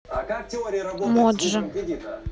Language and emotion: Russian, neutral